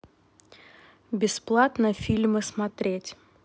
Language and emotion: Russian, neutral